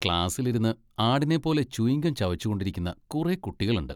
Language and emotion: Malayalam, disgusted